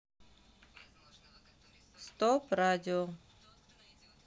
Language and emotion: Russian, neutral